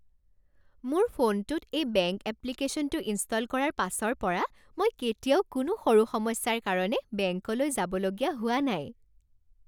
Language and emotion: Assamese, happy